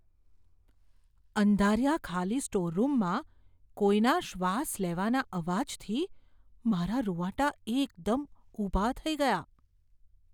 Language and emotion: Gujarati, fearful